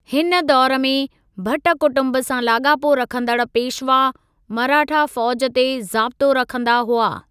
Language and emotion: Sindhi, neutral